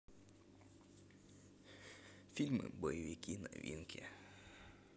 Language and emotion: Russian, neutral